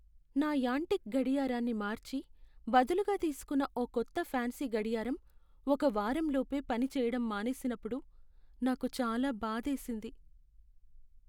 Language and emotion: Telugu, sad